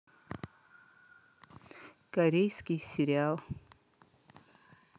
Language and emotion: Russian, neutral